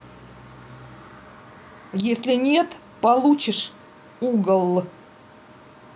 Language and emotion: Russian, angry